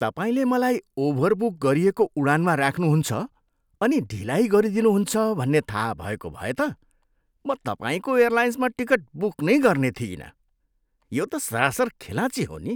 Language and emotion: Nepali, disgusted